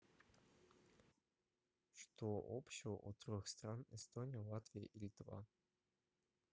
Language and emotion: Russian, neutral